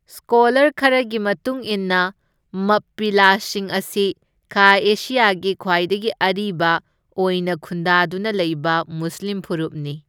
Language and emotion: Manipuri, neutral